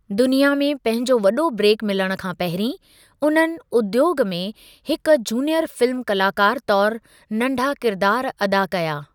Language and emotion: Sindhi, neutral